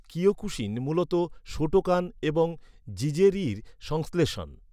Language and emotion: Bengali, neutral